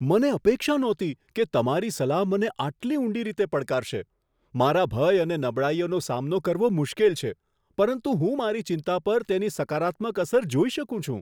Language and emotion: Gujarati, surprised